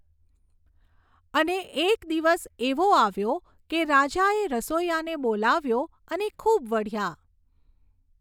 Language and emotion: Gujarati, neutral